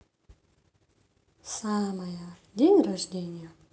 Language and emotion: Russian, neutral